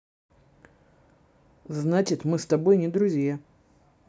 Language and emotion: Russian, neutral